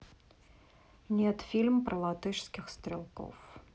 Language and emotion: Russian, neutral